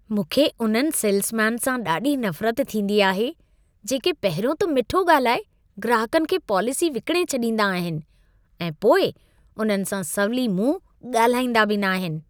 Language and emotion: Sindhi, disgusted